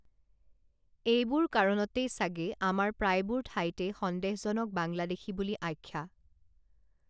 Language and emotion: Assamese, neutral